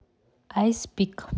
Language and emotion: Russian, neutral